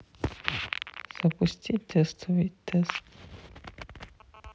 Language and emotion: Russian, neutral